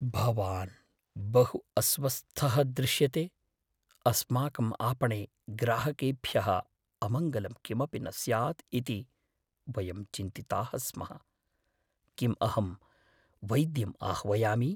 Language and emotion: Sanskrit, fearful